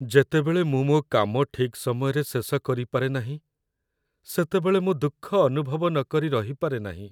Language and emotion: Odia, sad